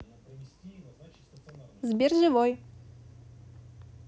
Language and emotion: Russian, neutral